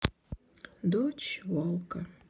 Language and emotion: Russian, sad